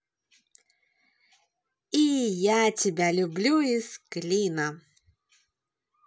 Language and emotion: Russian, positive